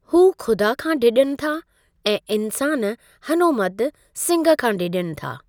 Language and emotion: Sindhi, neutral